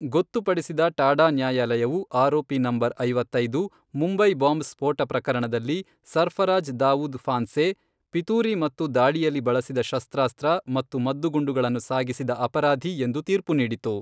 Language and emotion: Kannada, neutral